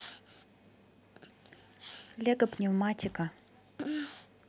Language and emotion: Russian, neutral